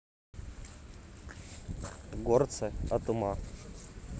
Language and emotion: Russian, neutral